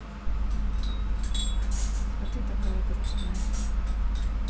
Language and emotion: Russian, sad